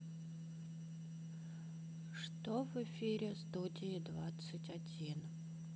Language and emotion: Russian, sad